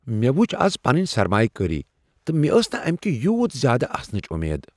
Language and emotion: Kashmiri, surprised